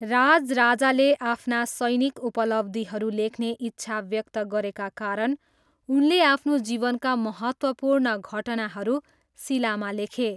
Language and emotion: Nepali, neutral